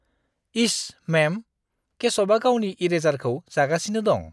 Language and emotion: Bodo, disgusted